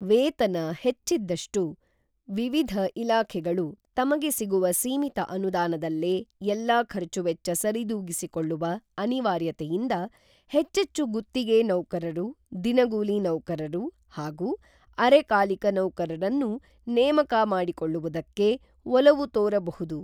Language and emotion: Kannada, neutral